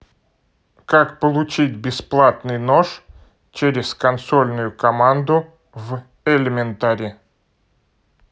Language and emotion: Russian, neutral